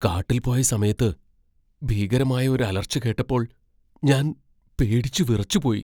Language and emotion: Malayalam, fearful